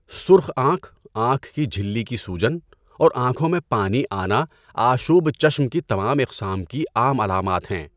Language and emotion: Urdu, neutral